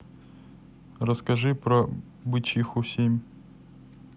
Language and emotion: Russian, neutral